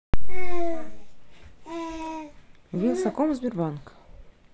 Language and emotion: Russian, neutral